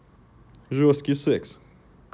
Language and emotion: Russian, neutral